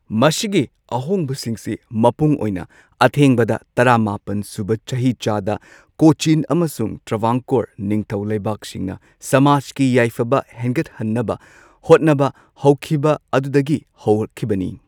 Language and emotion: Manipuri, neutral